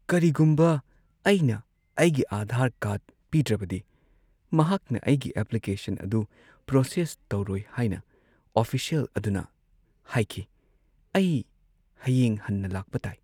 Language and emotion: Manipuri, sad